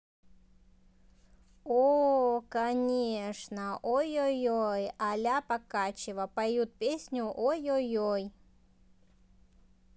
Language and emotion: Russian, positive